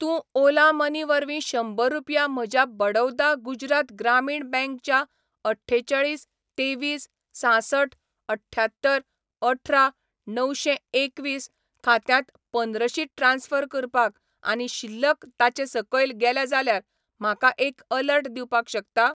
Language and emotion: Goan Konkani, neutral